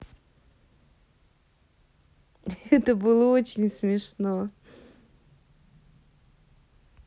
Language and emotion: Russian, positive